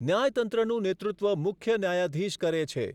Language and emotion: Gujarati, neutral